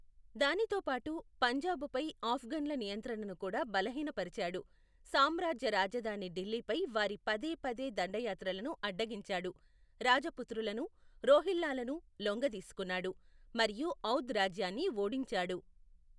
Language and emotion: Telugu, neutral